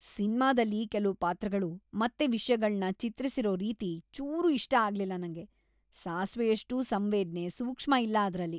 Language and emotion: Kannada, disgusted